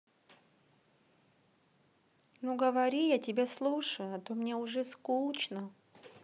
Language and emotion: Russian, sad